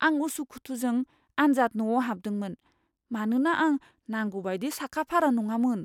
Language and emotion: Bodo, fearful